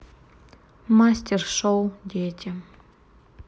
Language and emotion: Russian, neutral